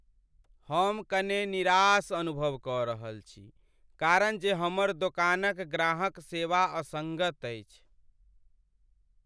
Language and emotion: Maithili, sad